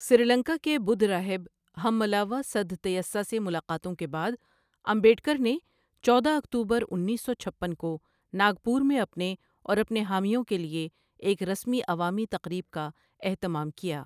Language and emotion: Urdu, neutral